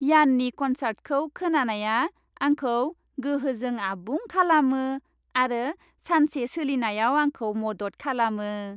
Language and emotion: Bodo, happy